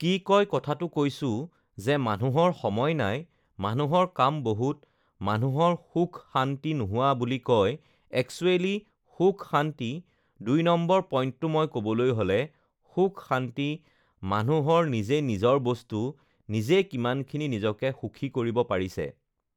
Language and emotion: Assamese, neutral